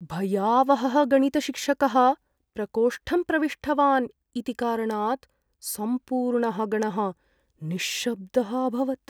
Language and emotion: Sanskrit, fearful